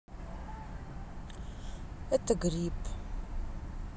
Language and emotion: Russian, sad